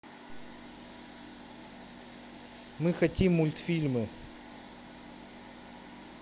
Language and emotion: Russian, neutral